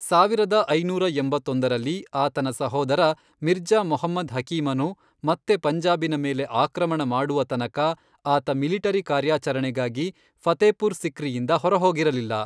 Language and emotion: Kannada, neutral